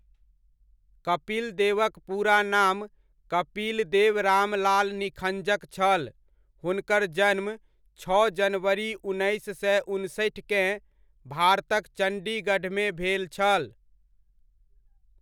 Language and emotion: Maithili, neutral